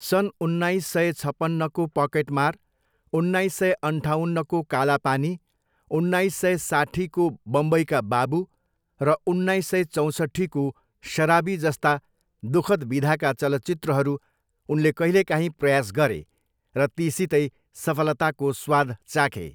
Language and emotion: Nepali, neutral